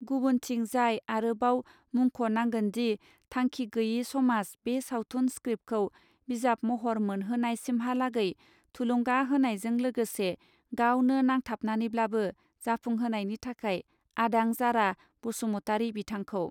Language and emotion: Bodo, neutral